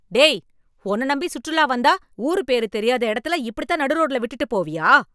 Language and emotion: Tamil, angry